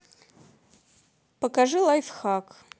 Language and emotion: Russian, neutral